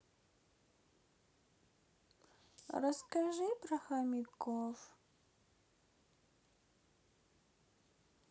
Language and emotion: Russian, sad